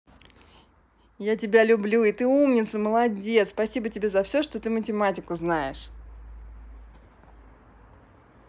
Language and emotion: Russian, positive